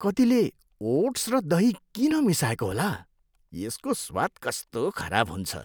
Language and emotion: Nepali, disgusted